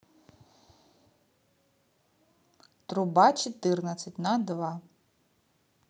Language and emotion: Russian, neutral